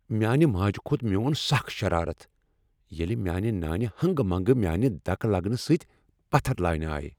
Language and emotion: Kashmiri, angry